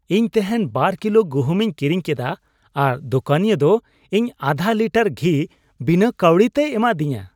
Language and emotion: Santali, happy